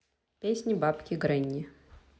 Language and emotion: Russian, neutral